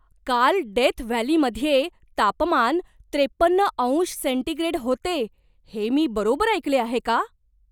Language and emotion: Marathi, surprised